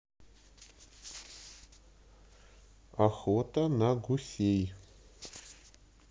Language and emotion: Russian, neutral